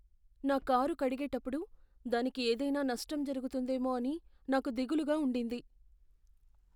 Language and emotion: Telugu, fearful